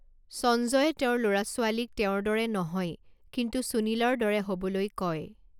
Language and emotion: Assamese, neutral